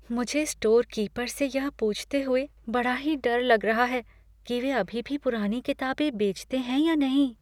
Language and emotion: Hindi, fearful